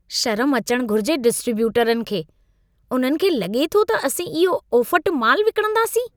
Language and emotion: Sindhi, disgusted